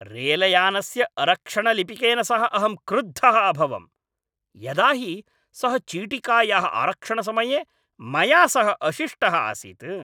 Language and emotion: Sanskrit, angry